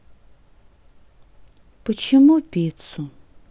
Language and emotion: Russian, sad